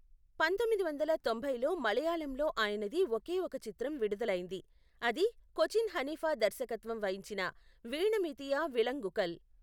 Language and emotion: Telugu, neutral